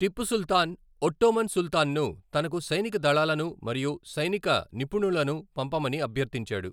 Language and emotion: Telugu, neutral